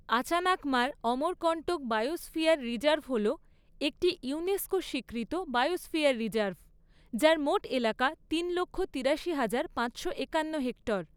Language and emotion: Bengali, neutral